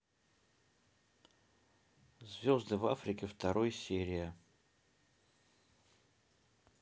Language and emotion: Russian, neutral